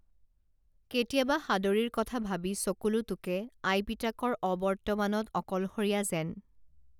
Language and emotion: Assamese, neutral